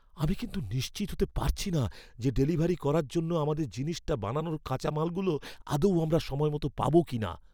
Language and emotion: Bengali, fearful